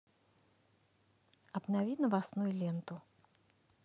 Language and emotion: Russian, neutral